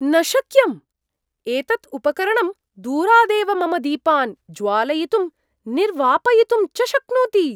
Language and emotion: Sanskrit, surprised